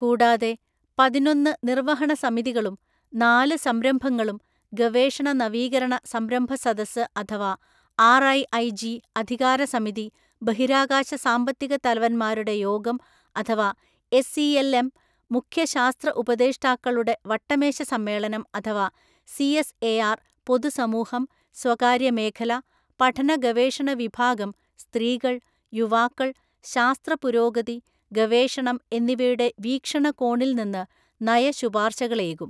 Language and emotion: Malayalam, neutral